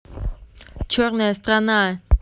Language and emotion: Russian, neutral